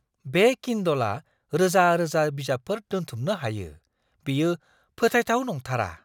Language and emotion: Bodo, surprised